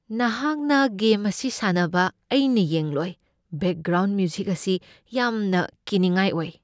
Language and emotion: Manipuri, fearful